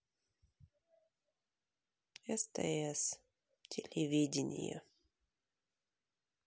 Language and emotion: Russian, sad